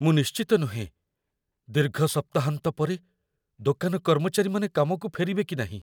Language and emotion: Odia, fearful